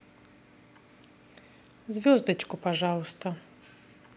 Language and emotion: Russian, neutral